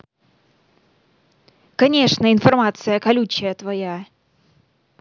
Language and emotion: Russian, angry